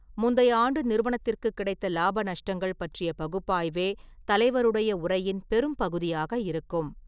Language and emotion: Tamil, neutral